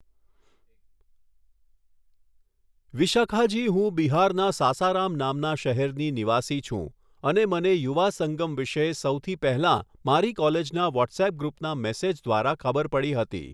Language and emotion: Gujarati, neutral